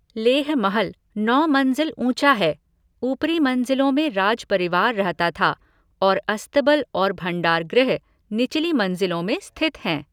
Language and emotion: Hindi, neutral